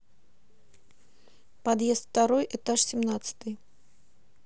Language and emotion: Russian, neutral